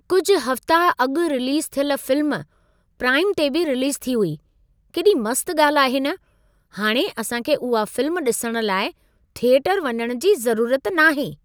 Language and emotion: Sindhi, surprised